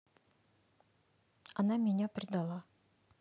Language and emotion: Russian, neutral